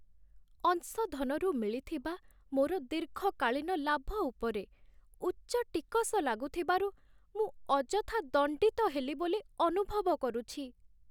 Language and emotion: Odia, sad